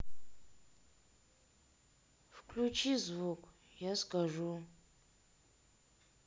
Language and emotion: Russian, sad